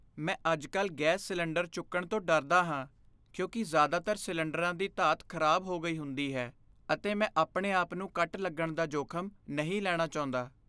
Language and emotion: Punjabi, fearful